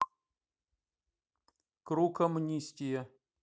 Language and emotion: Russian, neutral